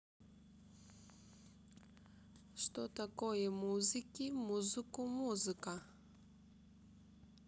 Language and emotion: Russian, neutral